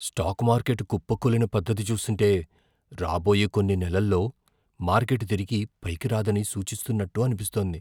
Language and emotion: Telugu, fearful